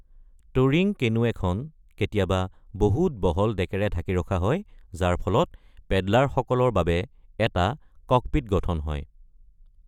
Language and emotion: Assamese, neutral